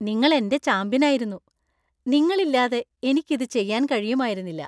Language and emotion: Malayalam, happy